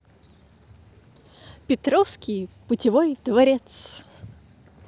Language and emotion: Russian, positive